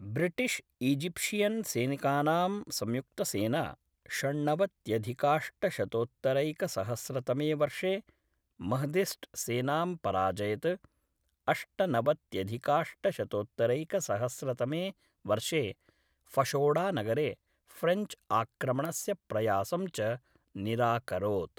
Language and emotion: Sanskrit, neutral